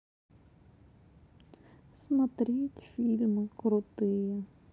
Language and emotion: Russian, sad